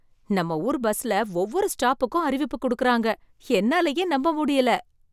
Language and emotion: Tamil, surprised